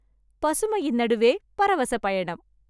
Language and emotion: Tamil, happy